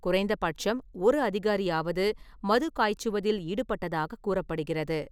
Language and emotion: Tamil, neutral